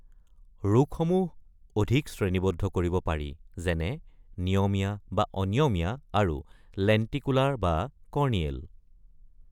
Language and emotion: Assamese, neutral